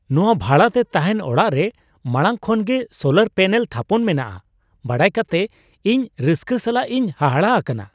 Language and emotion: Santali, surprised